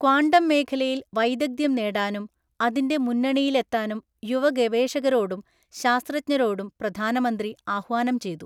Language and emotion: Malayalam, neutral